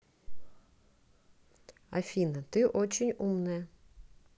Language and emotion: Russian, neutral